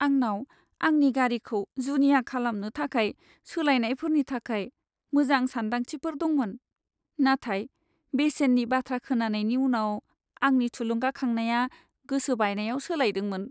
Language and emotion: Bodo, sad